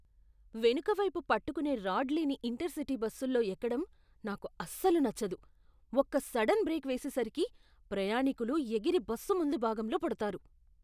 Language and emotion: Telugu, disgusted